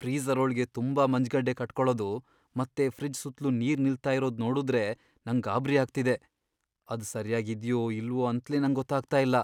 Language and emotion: Kannada, fearful